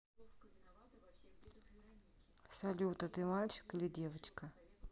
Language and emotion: Russian, neutral